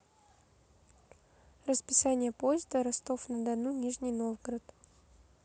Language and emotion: Russian, neutral